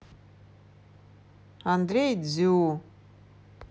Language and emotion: Russian, neutral